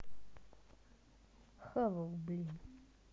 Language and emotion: Russian, neutral